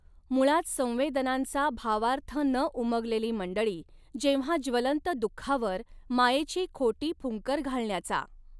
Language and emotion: Marathi, neutral